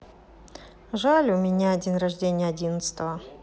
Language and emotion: Russian, sad